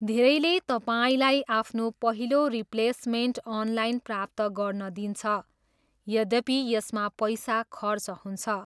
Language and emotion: Nepali, neutral